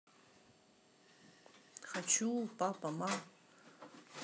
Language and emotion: Russian, neutral